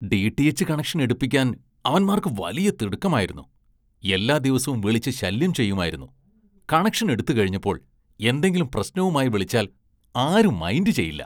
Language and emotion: Malayalam, disgusted